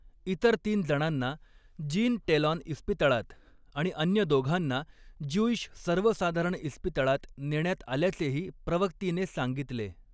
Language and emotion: Marathi, neutral